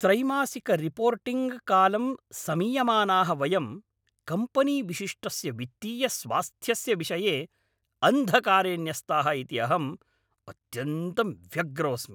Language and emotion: Sanskrit, angry